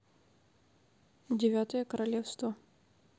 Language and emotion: Russian, neutral